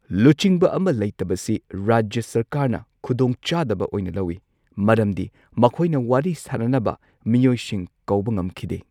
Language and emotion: Manipuri, neutral